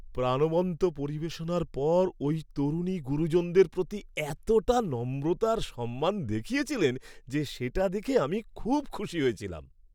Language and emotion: Bengali, happy